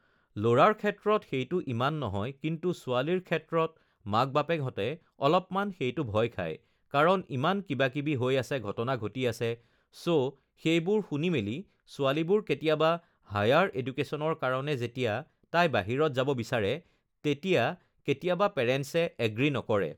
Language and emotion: Assamese, neutral